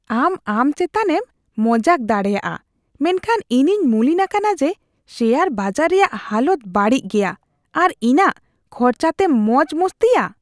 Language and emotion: Santali, disgusted